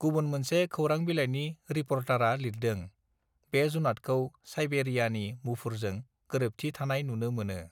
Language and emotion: Bodo, neutral